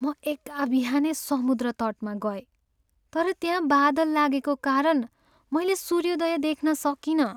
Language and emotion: Nepali, sad